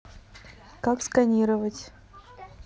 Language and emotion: Russian, neutral